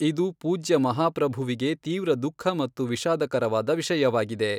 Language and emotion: Kannada, neutral